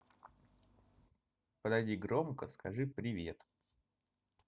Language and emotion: Russian, positive